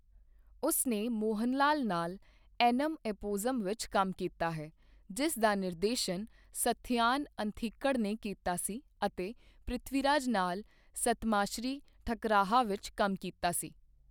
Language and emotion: Punjabi, neutral